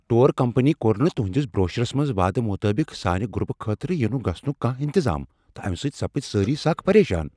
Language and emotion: Kashmiri, angry